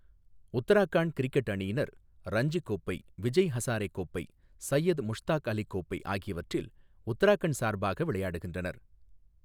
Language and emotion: Tamil, neutral